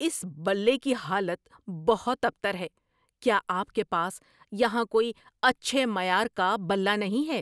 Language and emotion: Urdu, angry